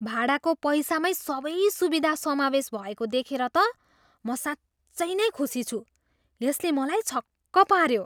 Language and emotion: Nepali, surprised